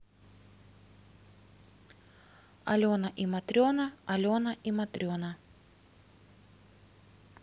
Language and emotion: Russian, neutral